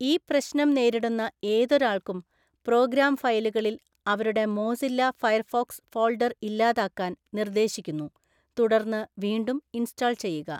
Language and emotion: Malayalam, neutral